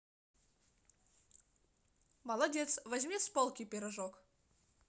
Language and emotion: Russian, positive